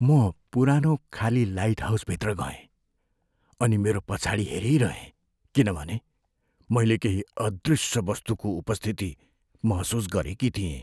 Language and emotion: Nepali, fearful